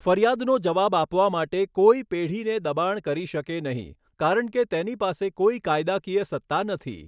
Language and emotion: Gujarati, neutral